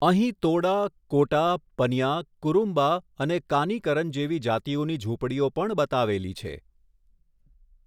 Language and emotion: Gujarati, neutral